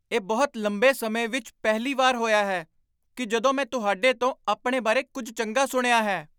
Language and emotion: Punjabi, surprised